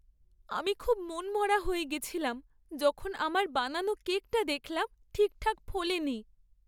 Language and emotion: Bengali, sad